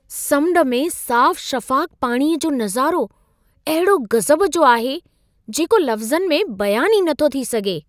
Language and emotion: Sindhi, surprised